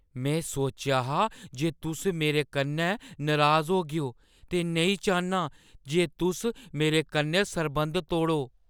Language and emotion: Dogri, fearful